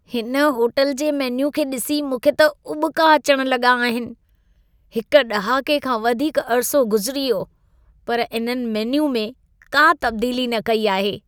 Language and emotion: Sindhi, disgusted